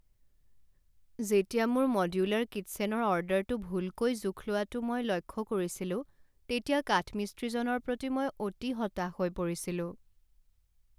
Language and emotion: Assamese, sad